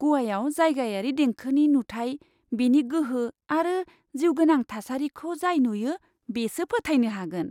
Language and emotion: Bodo, surprised